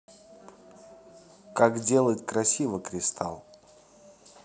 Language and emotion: Russian, neutral